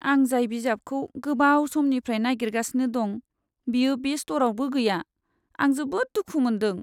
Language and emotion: Bodo, sad